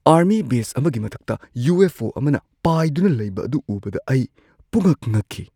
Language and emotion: Manipuri, surprised